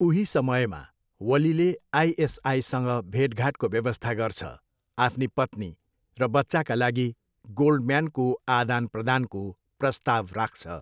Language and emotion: Nepali, neutral